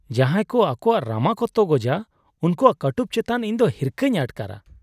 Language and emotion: Santali, disgusted